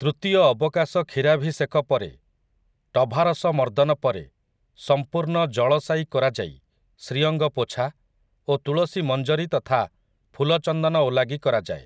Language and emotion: Odia, neutral